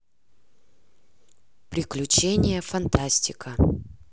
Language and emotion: Russian, neutral